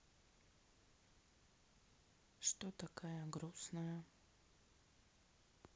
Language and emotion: Russian, sad